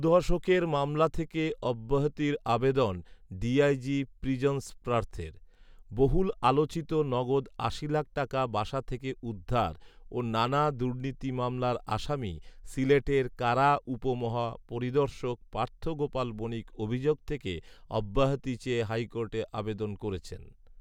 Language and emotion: Bengali, neutral